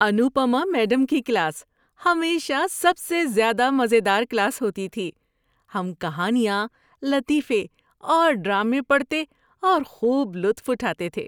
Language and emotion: Urdu, happy